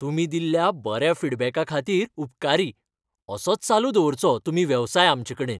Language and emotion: Goan Konkani, happy